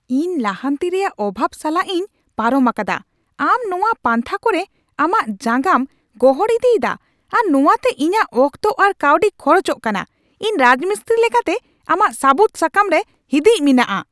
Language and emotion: Santali, angry